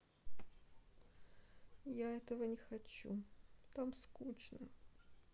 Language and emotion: Russian, sad